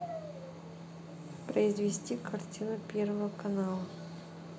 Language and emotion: Russian, neutral